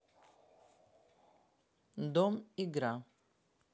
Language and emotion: Russian, neutral